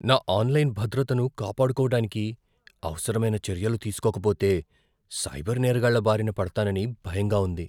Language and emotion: Telugu, fearful